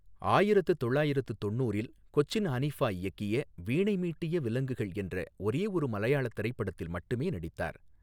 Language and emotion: Tamil, neutral